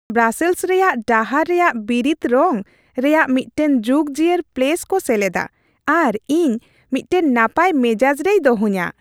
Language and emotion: Santali, happy